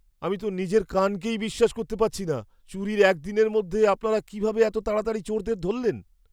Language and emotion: Bengali, surprised